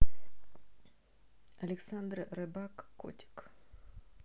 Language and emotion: Russian, neutral